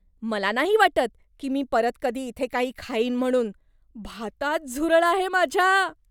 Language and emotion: Marathi, disgusted